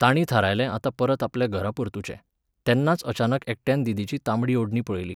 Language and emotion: Goan Konkani, neutral